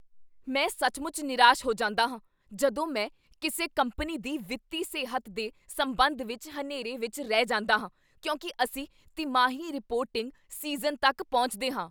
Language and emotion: Punjabi, angry